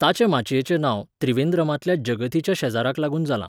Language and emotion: Goan Konkani, neutral